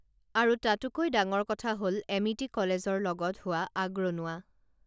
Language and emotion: Assamese, neutral